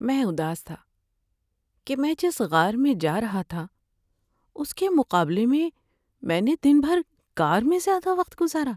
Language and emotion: Urdu, sad